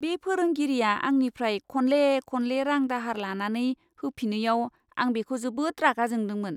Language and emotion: Bodo, disgusted